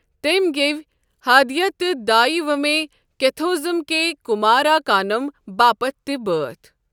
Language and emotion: Kashmiri, neutral